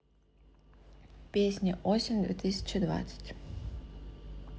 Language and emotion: Russian, neutral